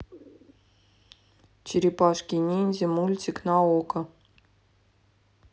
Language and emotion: Russian, neutral